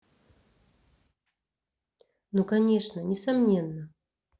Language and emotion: Russian, neutral